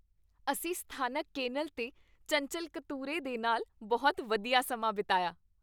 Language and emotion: Punjabi, happy